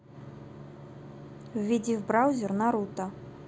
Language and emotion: Russian, neutral